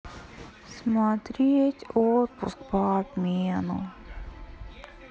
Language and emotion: Russian, sad